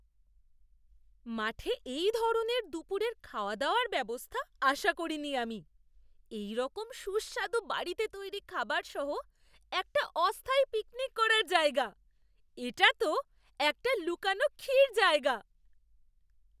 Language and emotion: Bengali, surprised